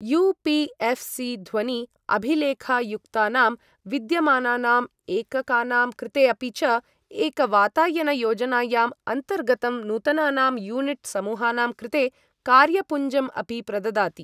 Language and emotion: Sanskrit, neutral